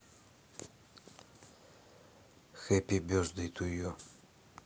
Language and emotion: Russian, neutral